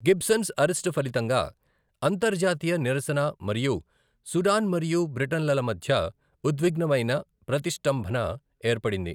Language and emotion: Telugu, neutral